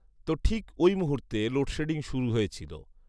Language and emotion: Bengali, neutral